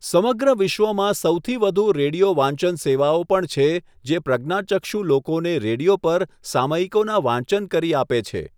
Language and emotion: Gujarati, neutral